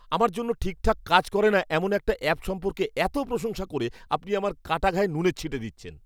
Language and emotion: Bengali, angry